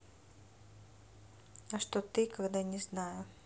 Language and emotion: Russian, neutral